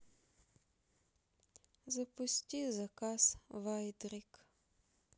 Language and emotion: Russian, sad